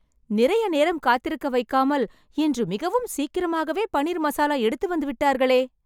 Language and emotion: Tamil, happy